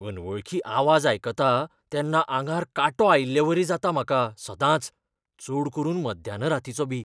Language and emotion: Goan Konkani, fearful